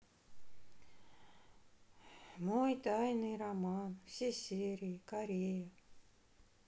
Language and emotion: Russian, sad